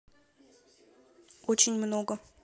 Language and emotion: Russian, neutral